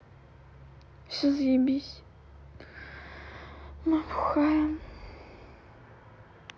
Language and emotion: Russian, sad